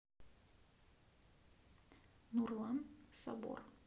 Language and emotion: Russian, neutral